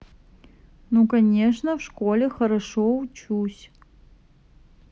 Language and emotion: Russian, neutral